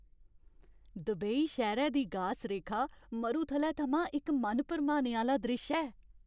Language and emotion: Dogri, happy